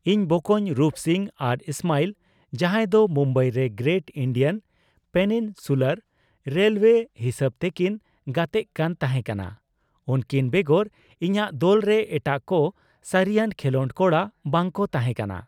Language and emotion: Santali, neutral